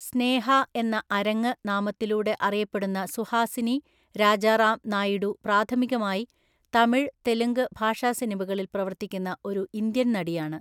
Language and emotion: Malayalam, neutral